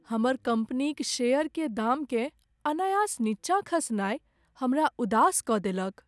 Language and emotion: Maithili, sad